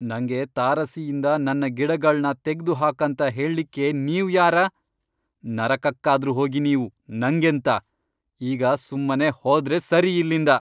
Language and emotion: Kannada, angry